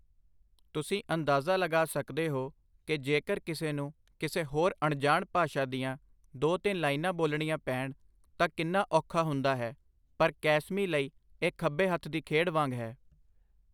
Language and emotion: Punjabi, neutral